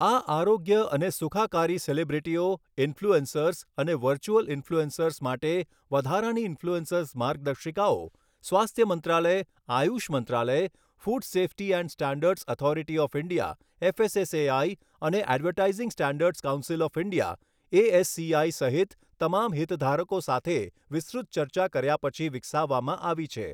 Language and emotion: Gujarati, neutral